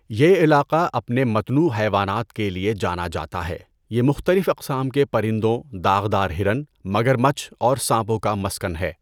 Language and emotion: Urdu, neutral